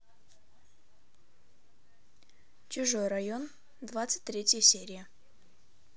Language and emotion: Russian, neutral